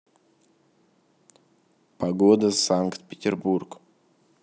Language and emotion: Russian, neutral